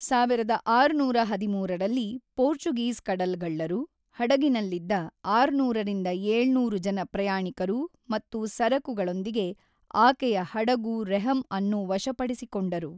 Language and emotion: Kannada, neutral